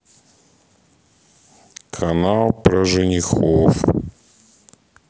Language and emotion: Russian, sad